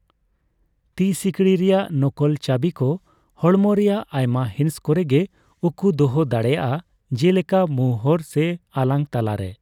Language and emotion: Santali, neutral